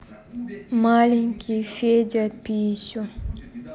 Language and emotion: Russian, neutral